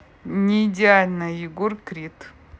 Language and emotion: Russian, neutral